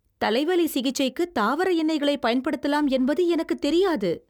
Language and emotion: Tamil, surprised